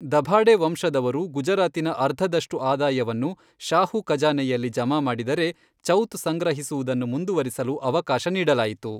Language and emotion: Kannada, neutral